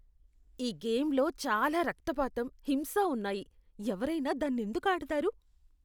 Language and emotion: Telugu, disgusted